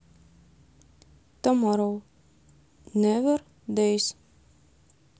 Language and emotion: Russian, neutral